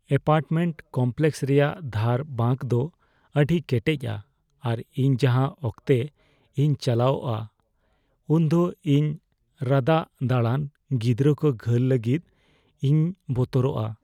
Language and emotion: Santali, fearful